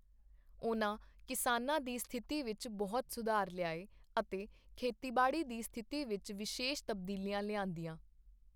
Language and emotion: Punjabi, neutral